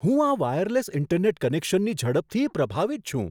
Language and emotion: Gujarati, surprised